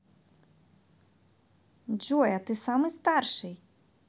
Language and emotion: Russian, positive